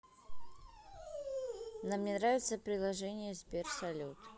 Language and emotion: Russian, neutral